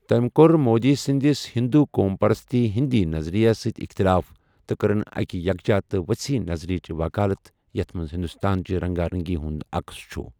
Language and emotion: Kashmiri, neutral